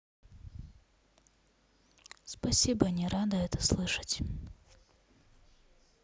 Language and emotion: Russian, sad